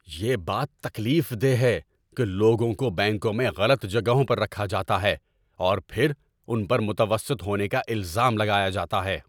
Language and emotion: Urdu, angry